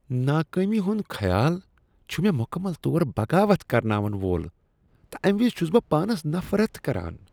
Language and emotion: Kashmiri, disgusted